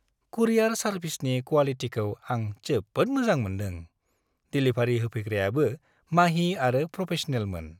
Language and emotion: Bodo, happy